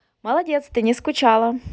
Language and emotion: Russian, positive